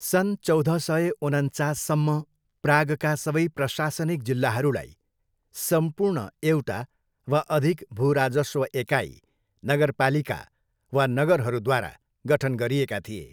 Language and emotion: Nepali, neutral